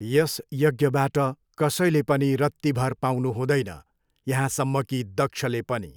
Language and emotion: Nepali, neutral